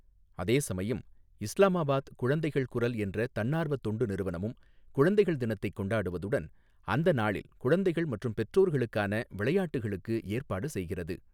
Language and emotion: Tamil, neutral